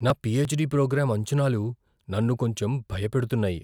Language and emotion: Telugu, fearful